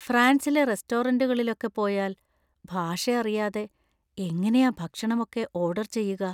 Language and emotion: Malayalam, fearful